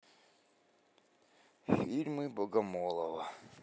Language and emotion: Russian, neutral